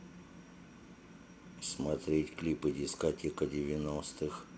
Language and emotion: Russian, neutral